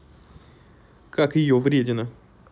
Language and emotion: Russian, neutral